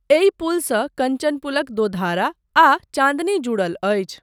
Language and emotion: Maithili, neutral